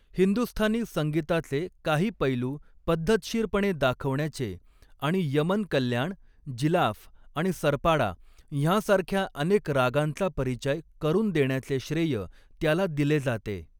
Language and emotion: Marathi, neutral